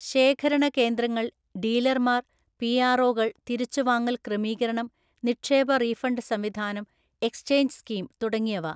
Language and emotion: Malayalam, neutral